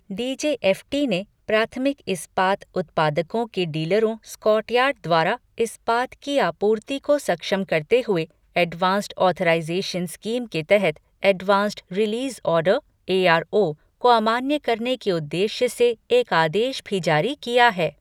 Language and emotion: Hindi, neutral